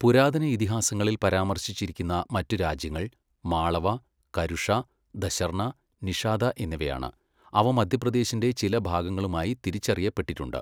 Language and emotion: Malayalam, neutral